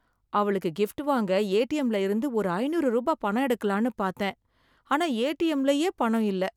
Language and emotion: Tamil, sad